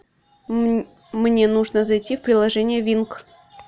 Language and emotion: Russian, neutral